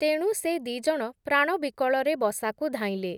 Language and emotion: Odia, neutral